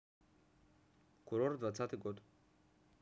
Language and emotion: Russian, neutral